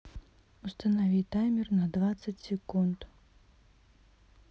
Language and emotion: Russian, neutral